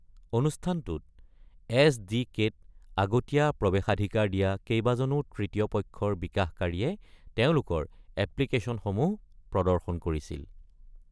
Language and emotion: Assamese, neutral